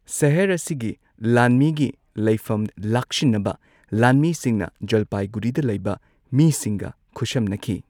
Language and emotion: Manipuri, neutral